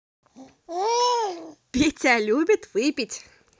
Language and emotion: Russian, positive